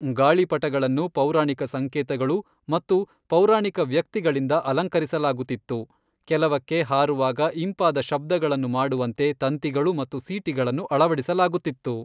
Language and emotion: Kannada, neutral